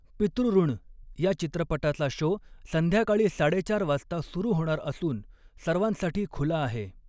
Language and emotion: Marathi, neutral